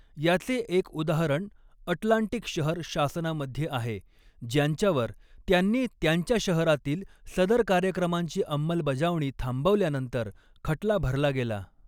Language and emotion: Marathi, neutral